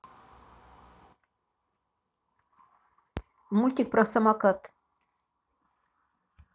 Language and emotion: Russian, neutral